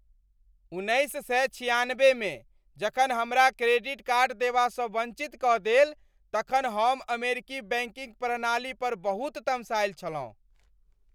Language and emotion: Maithili, angry